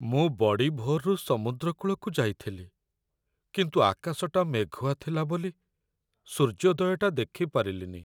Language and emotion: Odia, sad